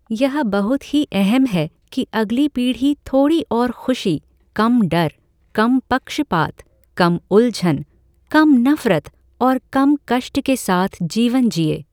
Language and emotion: Hindi, neutral